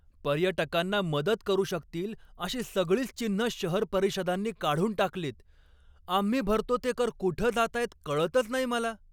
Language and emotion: Marathi, angry